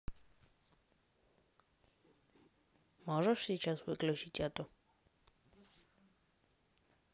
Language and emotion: Russian, neutral